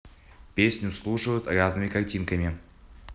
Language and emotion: Russian, neutral